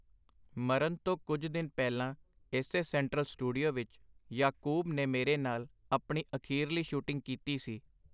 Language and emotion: Punjabi, neutral